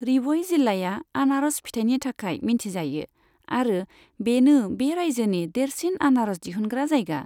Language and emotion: Bodo, neutral